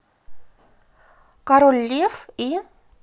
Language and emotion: Russian, positive